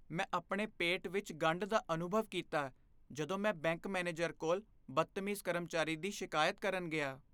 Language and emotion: Punjabi, fearful